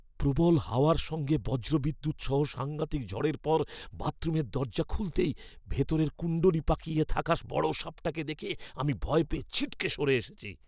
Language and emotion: Bengali, fearful